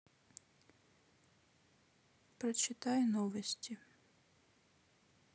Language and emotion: Russian, sad